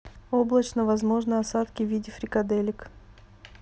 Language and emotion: Russian, neutral